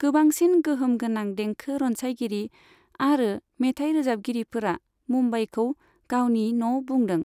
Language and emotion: Bodo, neutral